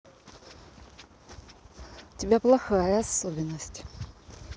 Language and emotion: Russian, angry